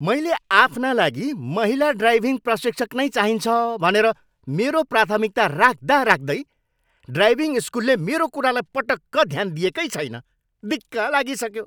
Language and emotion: Nepali, angry